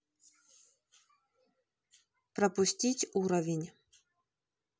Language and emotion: Russian, neutral